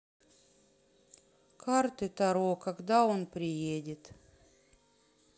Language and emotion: Russian, sad